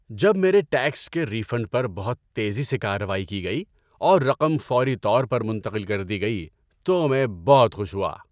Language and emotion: Urdu, happy